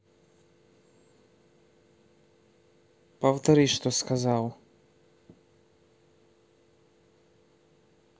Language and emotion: Russian, neutral